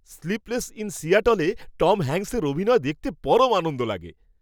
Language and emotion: Bengali, happy